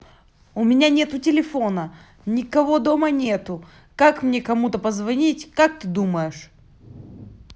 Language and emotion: Russian, angry